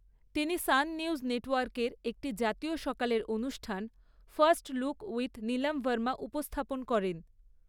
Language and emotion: Bengali, neutral